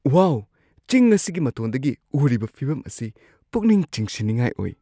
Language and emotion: Manipuri, surprised